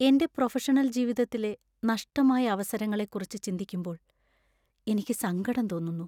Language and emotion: Malayalam, sad